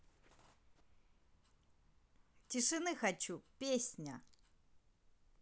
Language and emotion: Russian, neutral